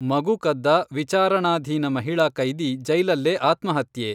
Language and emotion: Kannada, neutral